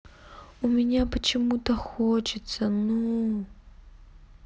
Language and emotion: Russian, sad